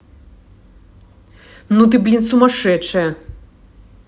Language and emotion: Russian, angry